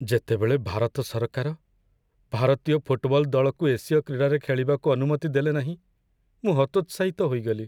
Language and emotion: Odia, sad